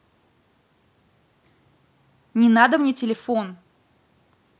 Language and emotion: Russian, angry